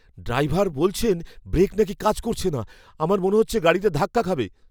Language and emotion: Bengali, fearful